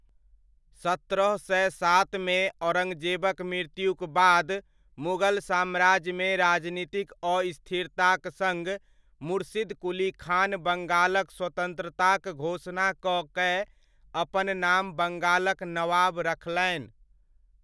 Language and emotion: Maithili, neutral